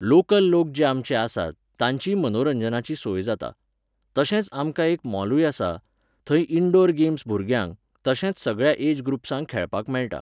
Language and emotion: Goan Konkani, neutral